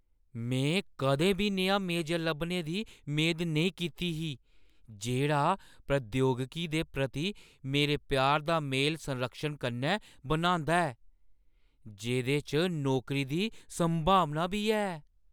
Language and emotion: Dogri, surprised